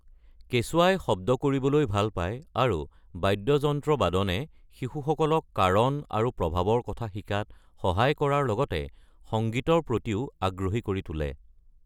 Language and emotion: Assamese, neutral